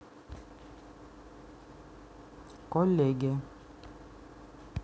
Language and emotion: Russian, neutral